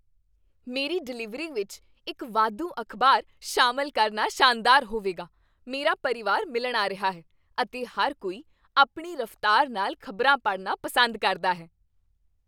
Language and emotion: Punjabi, happy